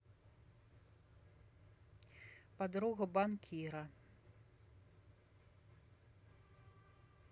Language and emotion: Russian, neutral